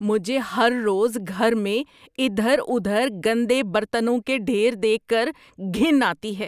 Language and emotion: Urdu, disgusted